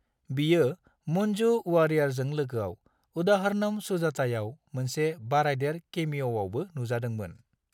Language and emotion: Bodo, neutral